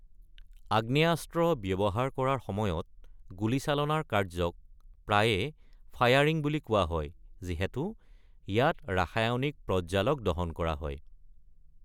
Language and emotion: Assamese, neutral